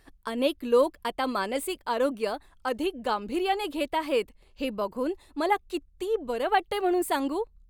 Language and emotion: Marathi, happy